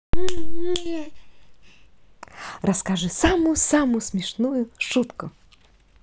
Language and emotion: Russian, positive